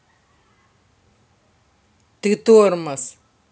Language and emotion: Russian, angry